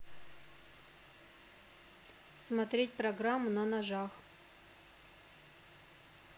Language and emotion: Russian, neutral